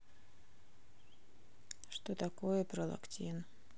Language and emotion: Russian, neutral